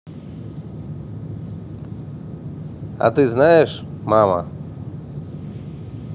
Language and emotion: Russian, neutral